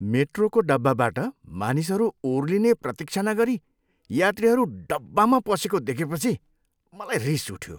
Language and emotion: Nepali, disgusted